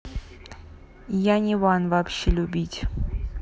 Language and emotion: Russian, neutral